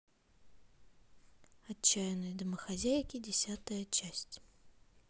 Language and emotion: Russian, neutral